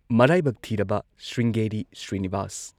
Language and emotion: Manipuri, neutral